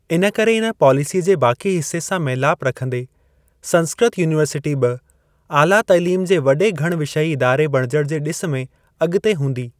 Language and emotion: Sindhi, neutral